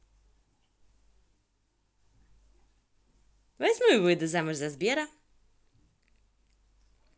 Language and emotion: Russian, positive